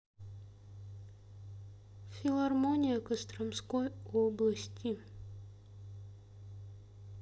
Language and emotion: Russian, sad